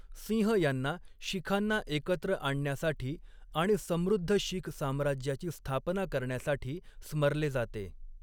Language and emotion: Marathi, neutral